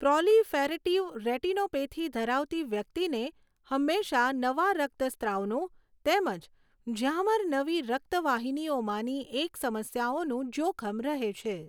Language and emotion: Gujarati, neutral